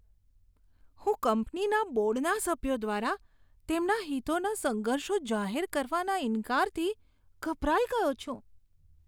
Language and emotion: Gujarati, disgusted